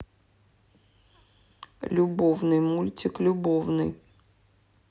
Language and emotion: Russian, sad